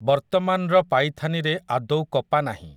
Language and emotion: Odia, neutral